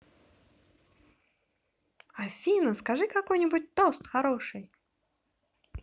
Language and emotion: Russian, positive